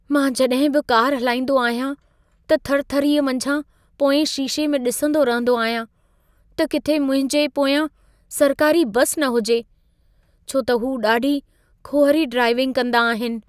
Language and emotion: Sindhi, fearful